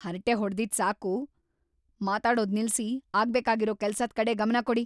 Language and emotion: Kannada, angry